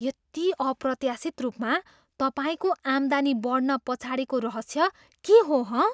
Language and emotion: Nepali, surprised